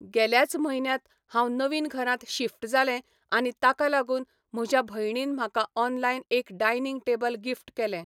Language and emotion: Goan Konkani, neutral